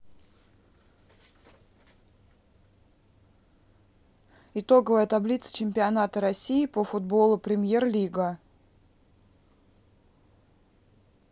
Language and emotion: Russian, neutral